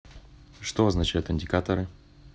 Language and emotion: Russian, neutral